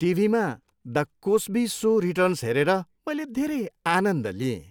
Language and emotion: Nepali, happy